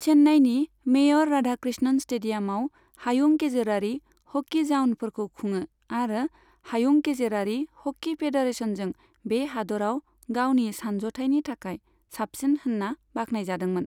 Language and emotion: Bodo, neutral